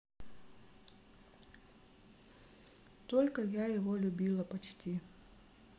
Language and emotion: Russian, sad